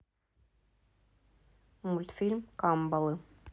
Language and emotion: Russian, neutral